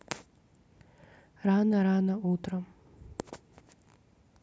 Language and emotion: Russian, neutral